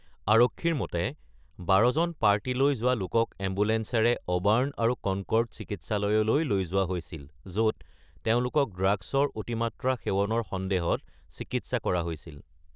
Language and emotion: Assamese, neutral